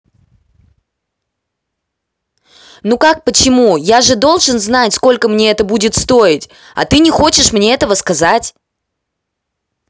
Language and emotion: Russian, angry